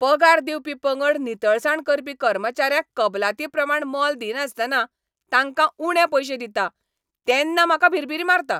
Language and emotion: Goan Konkani, angry